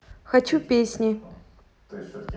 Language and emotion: Russian, neutral